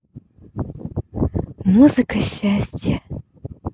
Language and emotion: Russian, positive